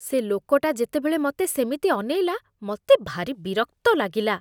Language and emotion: Odia, disgusted